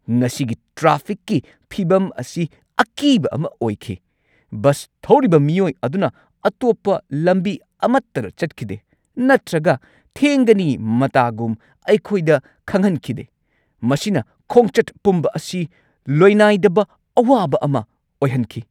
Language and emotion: Manipuri, angry